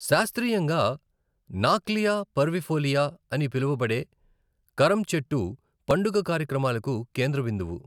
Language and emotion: Telugu, neutral